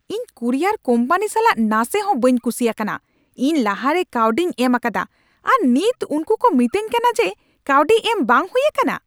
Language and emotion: Santali, angry